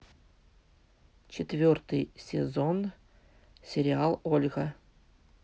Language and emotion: Russian, neutral